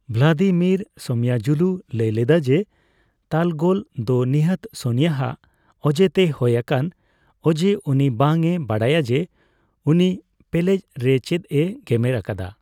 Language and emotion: Santali, neutral